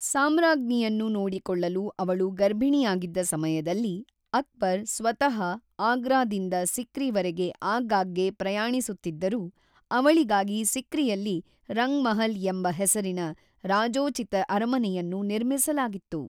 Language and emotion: Kannada, neutral